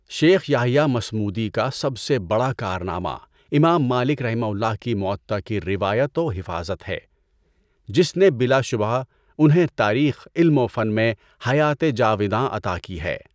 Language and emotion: Urdu, neutral